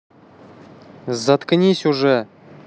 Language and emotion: Russian, angry